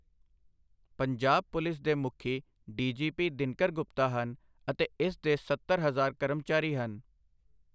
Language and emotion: Punjabi, neutral